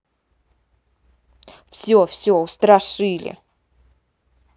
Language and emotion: Russian, angry